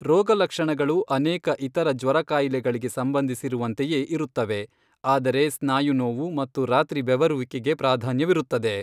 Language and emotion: Kannada, neutral